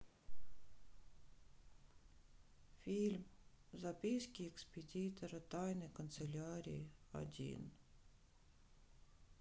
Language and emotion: Russian, sad